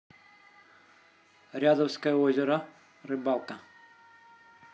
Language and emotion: Russian, neutral